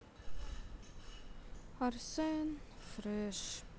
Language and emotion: Russian, sad